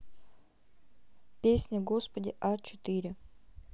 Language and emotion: Russian, neutral